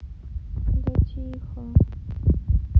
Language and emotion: Russian, sad